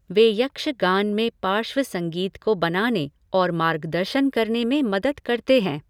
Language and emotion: Hindi, neutral